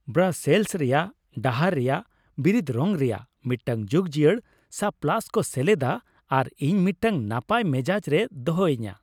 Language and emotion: Santali, happy